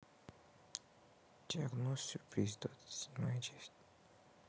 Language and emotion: Russian, sad